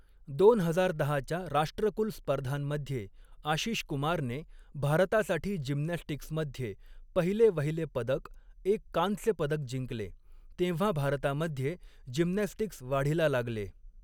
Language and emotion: Marathi, neutral